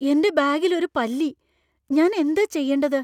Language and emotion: Malayalam, fearful